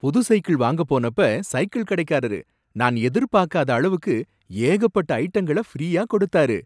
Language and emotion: Tamil, surprised